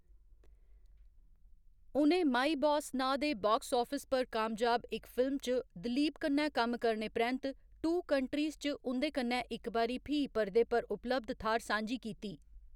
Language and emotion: Dogri, neutral